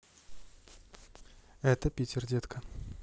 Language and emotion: Russian, neutral